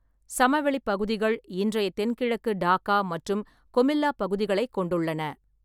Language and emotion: Tamil, neutral